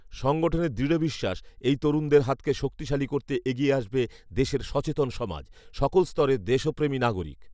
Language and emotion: Bengali, neutral